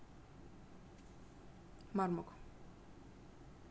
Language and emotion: Russian, neutral